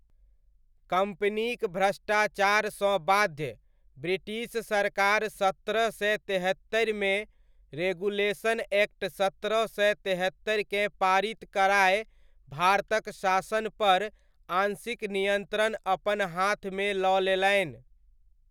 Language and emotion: Maithili, neutral